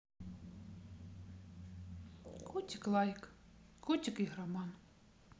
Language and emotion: Russian, neutral